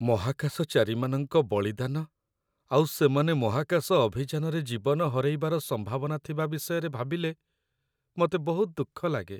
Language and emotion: Odia, sad